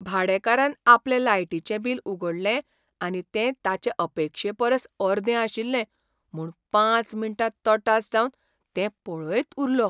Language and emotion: Goan Konkani, surprised